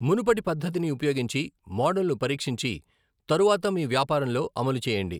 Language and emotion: Telugu, neutral